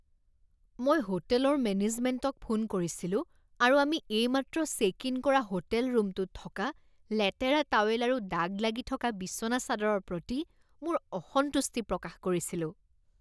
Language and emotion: Assamese, disgusted